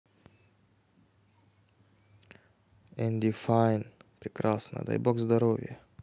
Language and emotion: Russian, neutral